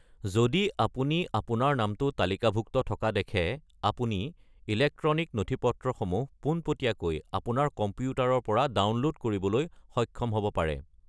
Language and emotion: Assamese, neutral